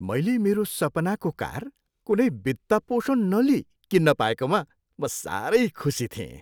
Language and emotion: Nepali, happy